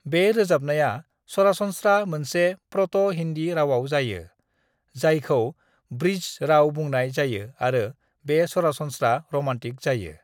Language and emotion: Bodo, neutral